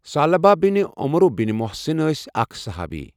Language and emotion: Kashmiri, neutral